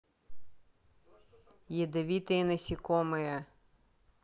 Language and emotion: Russian, neutral